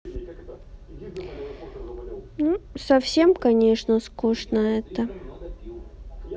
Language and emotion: Russian, sad